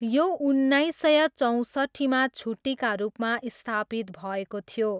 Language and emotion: Nepali, neutral